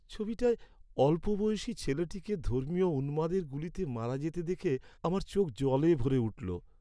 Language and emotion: Bengali, sad